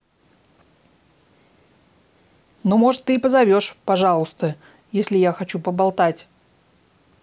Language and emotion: Russian, angry